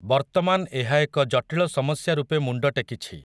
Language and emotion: Odia, neutral